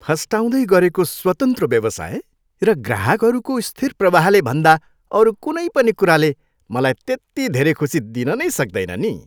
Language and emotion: Nepali, happy